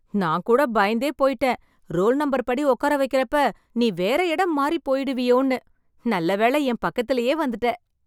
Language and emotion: Tamil, happy